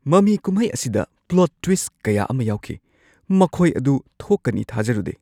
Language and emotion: Manipuri, surprised